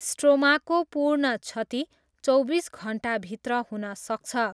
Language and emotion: Nepali, neutral